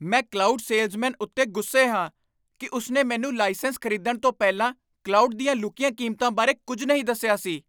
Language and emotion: Punjabi, angry